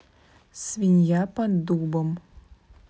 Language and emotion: Russian, neutral